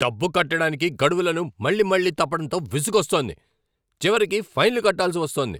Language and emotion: Telugu, angry